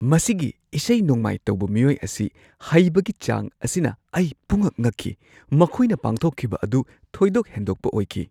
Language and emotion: Manipuri, surprised